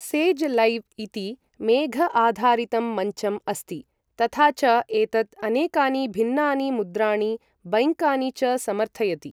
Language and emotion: Sanskrit, neutral